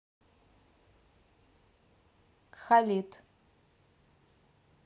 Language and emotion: Russian, neutral